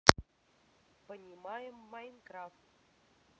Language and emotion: Russian, neutral